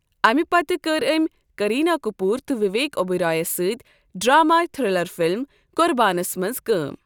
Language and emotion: Kashmiri, neutral